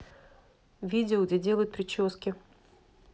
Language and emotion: Russian, neutral